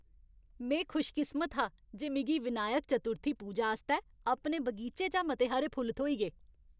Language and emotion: Dogri, happy